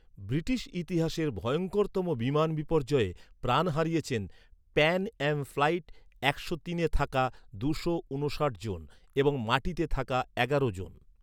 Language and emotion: Bengali, neutral